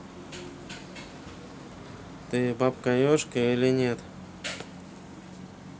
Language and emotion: Russian, neutral